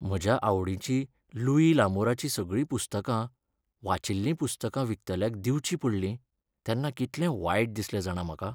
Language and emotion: Goan Konkani, sad